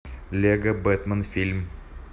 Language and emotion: Russian, neutral